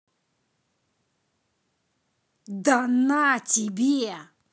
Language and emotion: Russian, angry